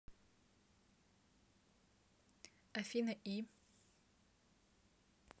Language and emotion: Russian, neutral